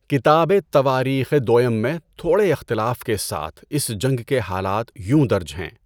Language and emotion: Urdu, neutral